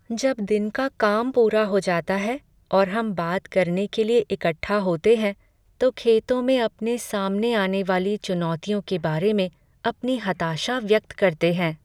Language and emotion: Hindi, sad